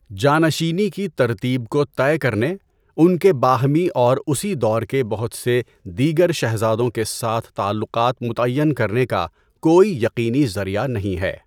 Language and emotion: Urdu, neutral